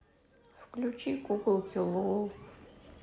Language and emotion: Russian, sad